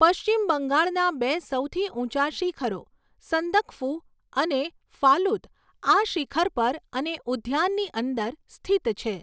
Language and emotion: Gujarati, neutral